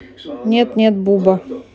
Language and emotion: Russian, neutral